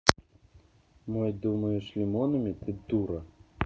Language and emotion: Russian, angry